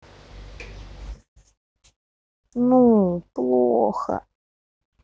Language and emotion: Russian, sad